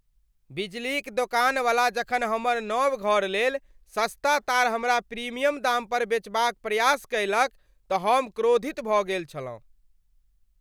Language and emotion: Maithili, angry